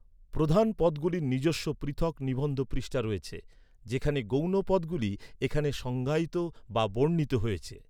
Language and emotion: Bengali, neutral